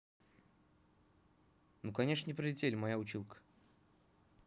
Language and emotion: Russian, neutral